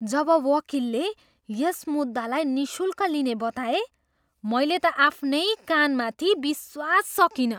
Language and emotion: Nepali, surprised